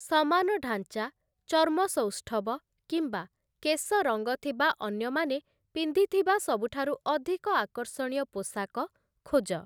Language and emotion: Odia, neutral